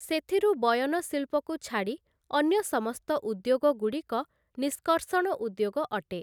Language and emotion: Odia, neutral